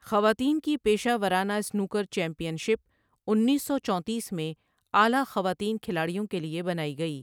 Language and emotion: Urdu, neutral